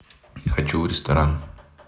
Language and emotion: Russian, neutral